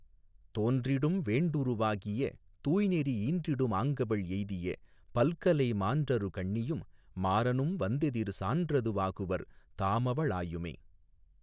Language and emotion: Tamil, neutral